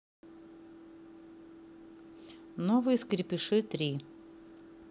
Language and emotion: Russian, neutral